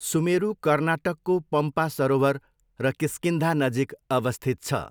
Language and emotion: Nepali, neutral